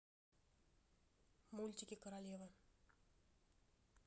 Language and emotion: Russian, neutral